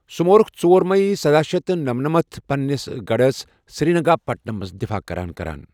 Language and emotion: Kashmiri, neutral